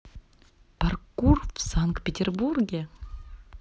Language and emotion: Russian, neutral